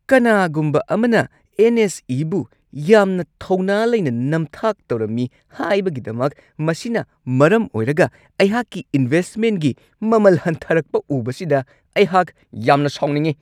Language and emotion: Manipuri, angry